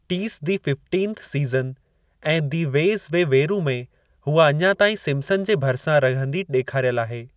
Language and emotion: Sindhi, neutral